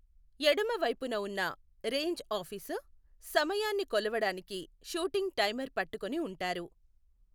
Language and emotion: Telugu, neutral